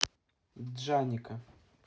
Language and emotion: Russian, neutral